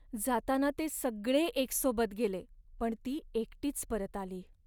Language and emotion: Marathi, sad